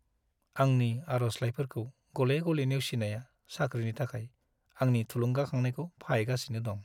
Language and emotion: Bodo, sad